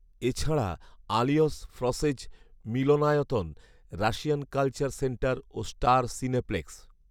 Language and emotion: Bengali, neutral